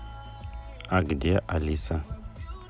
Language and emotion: Russian, neutral